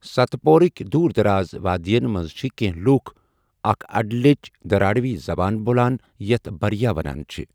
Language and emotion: Kashmiri, neutral